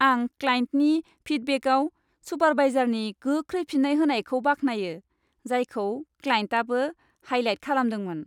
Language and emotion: Bodo, happy